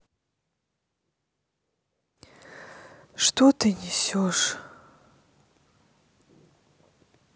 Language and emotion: Russian, sad